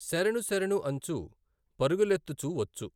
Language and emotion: Telugu, neutral